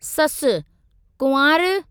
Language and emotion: Sindhi, neutral